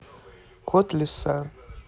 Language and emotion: Russian, neutral